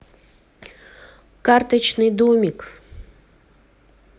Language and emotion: Russian, neutral